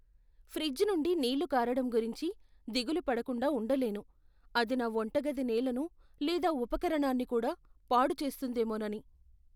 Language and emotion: Telugu, fearful